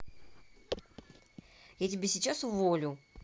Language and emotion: Russian, angry